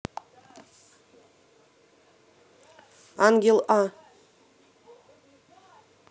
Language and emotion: Russian, neutral